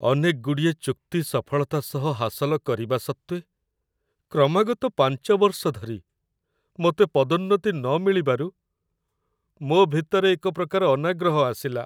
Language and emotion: Odia, sad